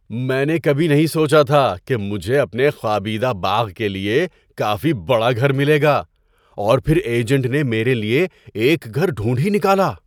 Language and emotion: Urdu, surprised